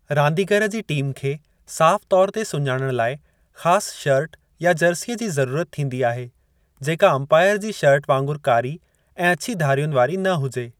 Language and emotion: Sindhi, neutral